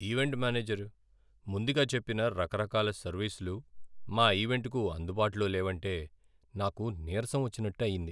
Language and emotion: Telugu, sad